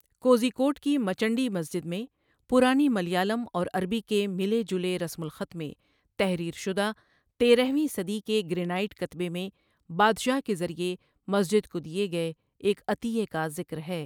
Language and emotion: Urdu, neutral